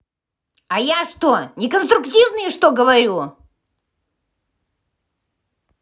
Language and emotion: Russian, angry